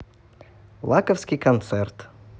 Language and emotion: Russian, positive